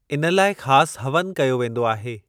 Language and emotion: Sindhi, neutral